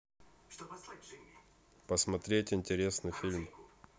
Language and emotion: Russian, neutral